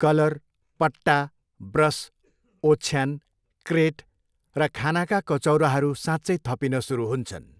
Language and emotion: Nepali, neutral